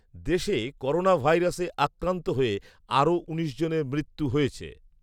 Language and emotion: Bengali, neutral